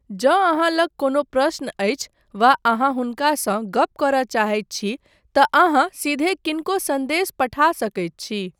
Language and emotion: Maithili, neutral